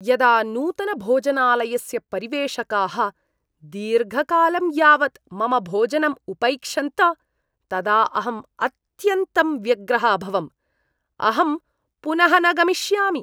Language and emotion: Sanskrit, disgusted